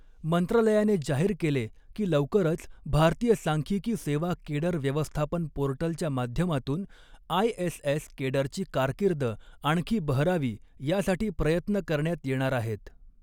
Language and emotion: Marathi, neutral